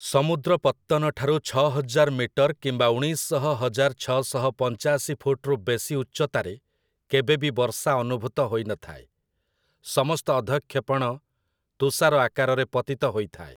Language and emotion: Odia, neutral